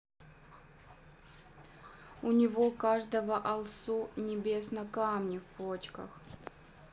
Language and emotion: Russian, neutral